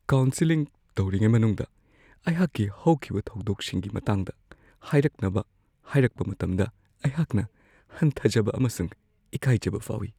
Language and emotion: Manipuri, fearful